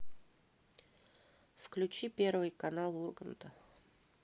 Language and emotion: Russian, neutral